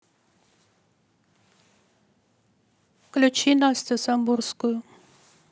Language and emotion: Russian, neutral